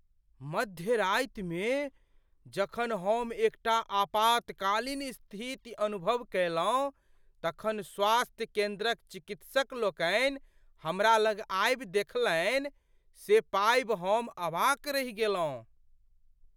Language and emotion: Maithili, surprised